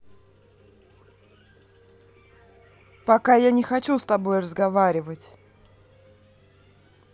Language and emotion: Russian, angry